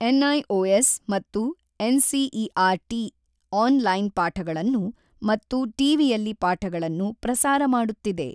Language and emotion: Kannada, neutral